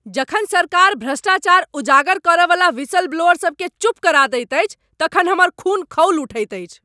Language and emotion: Maithili, angry